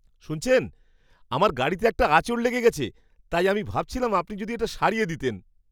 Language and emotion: Bengali, surprised